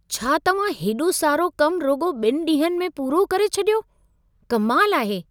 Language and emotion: Sindhi, surprised